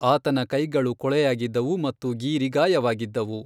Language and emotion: Kannada, neutral